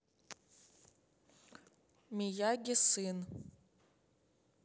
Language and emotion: Russian, neutral